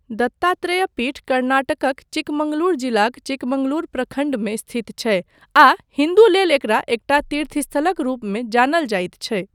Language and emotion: Maithili, neutral